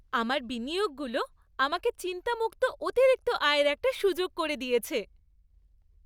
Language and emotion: Bengali, happy